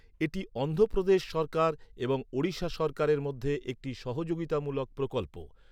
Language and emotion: Bengali, neutral